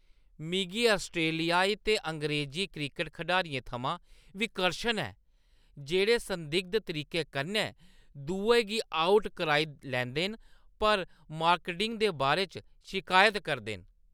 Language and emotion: Dogri, disgusted